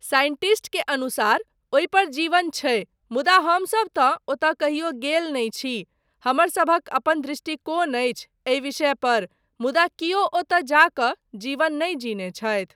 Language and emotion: Maithili, neutral